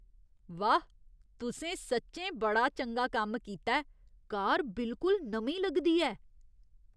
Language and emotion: Dogri, surprised